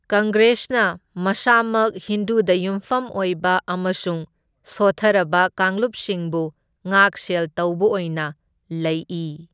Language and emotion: Manipuri, neutral